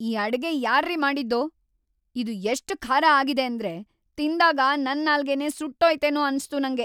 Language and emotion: Kannada, angry